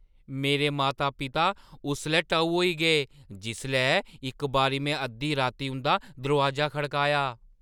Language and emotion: Dogri, surprised